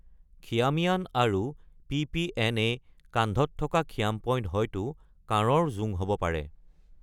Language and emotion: Assamese, neutral